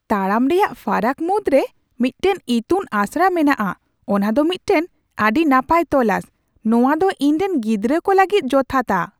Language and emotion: Santali, surprised